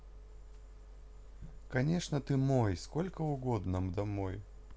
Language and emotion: Russian, neutral